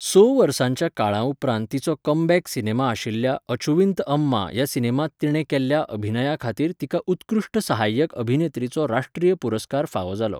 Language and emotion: Goan Konkani, neutral